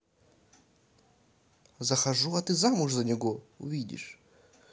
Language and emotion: Russian, neutral